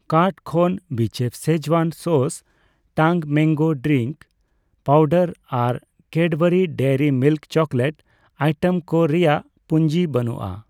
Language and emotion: Santali, neutral